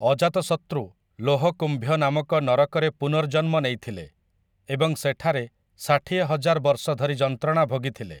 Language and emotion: Odia, neutral